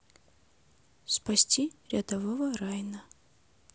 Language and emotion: Russian, neutral